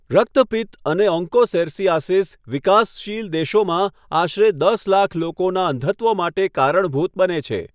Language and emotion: Gujarati, neutral